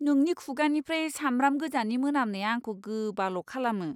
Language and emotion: Bodo, disgusted